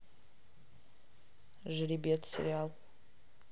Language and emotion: Russian, neutral